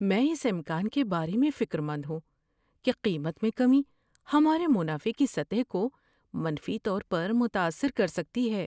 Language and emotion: Urdu, fearful